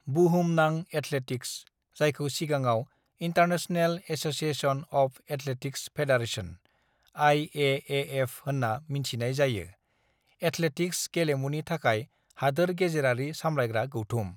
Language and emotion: Bodo, neutral